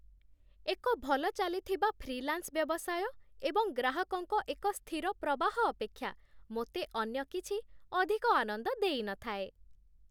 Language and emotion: Odia, happy